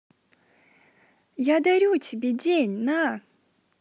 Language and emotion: Russian, positive